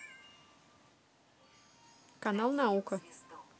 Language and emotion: Russian, neutral